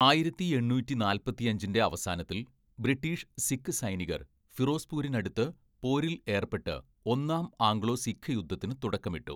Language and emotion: Malayalam, neutral